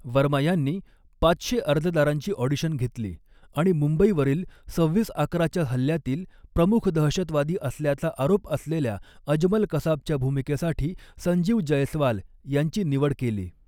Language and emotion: Marathi, neutral